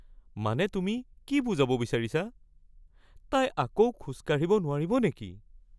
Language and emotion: Assamese, fearful